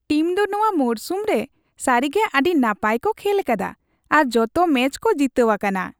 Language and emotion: Santali, happy